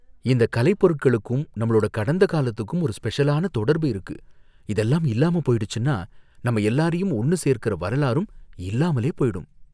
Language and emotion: Tamil, fearful